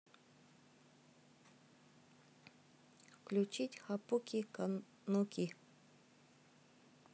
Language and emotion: Russian, neutral